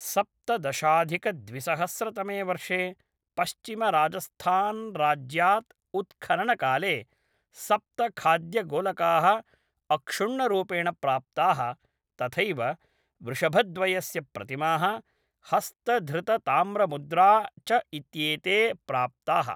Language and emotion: Sanskrit, neutral